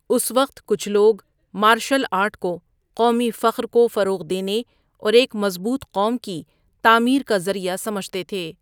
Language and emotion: Urdu, neutral